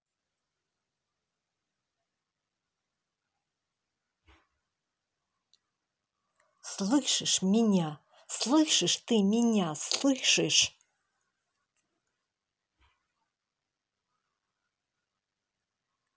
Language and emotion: Russian, angry